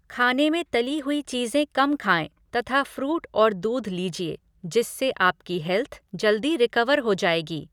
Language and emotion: Hindi, neutral